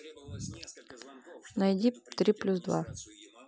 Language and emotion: Russian, neutral